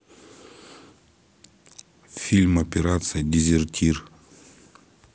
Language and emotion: Russian, neutral